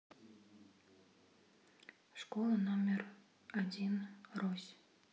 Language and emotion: Russian, sad